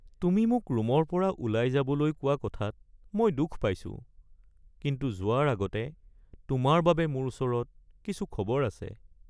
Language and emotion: Assamese, sad